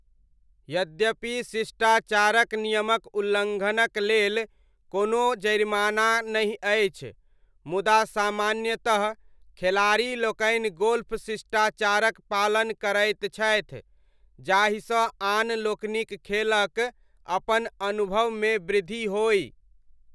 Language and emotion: Maithili, neutral